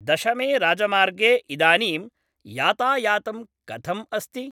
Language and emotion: Sanskrit, neutral